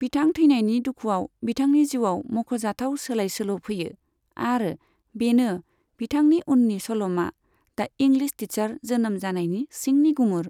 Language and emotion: Bodo, neutral